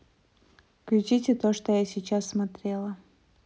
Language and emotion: Russian, neutral